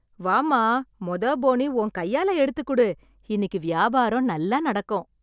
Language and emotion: Tamil, happy